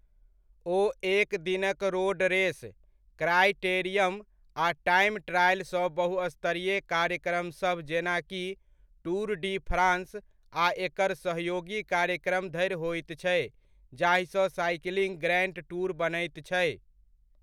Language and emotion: Maithili, neutral